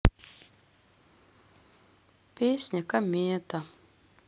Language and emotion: Russian, sad